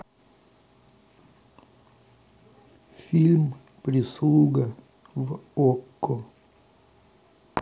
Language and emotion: Russian, neutral